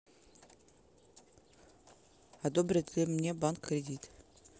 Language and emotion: Russian, neutral